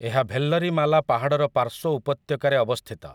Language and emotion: Odia, neutral